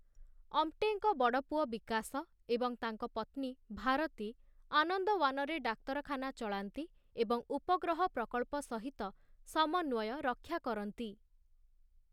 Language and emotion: Odia, neutral